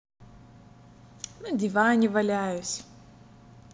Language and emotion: Russian, positive